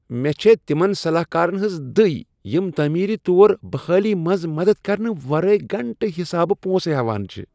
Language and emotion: Kashmiri, disgusted